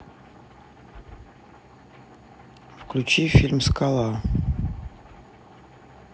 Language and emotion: Russian, neutral